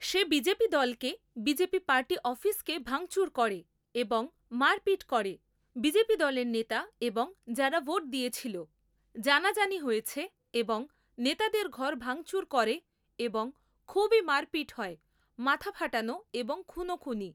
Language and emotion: Bengali, neutral